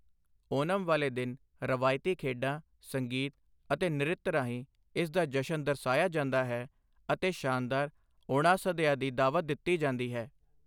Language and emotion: Punjabi, neutral